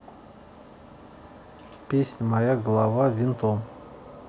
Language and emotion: Russian, neutral